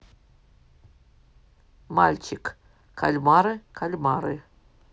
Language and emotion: Russian, neutral